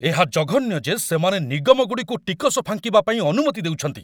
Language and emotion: Odia, angry